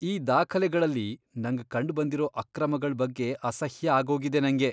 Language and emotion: Kannada, disgusted